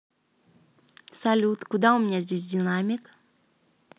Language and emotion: Russian, neutral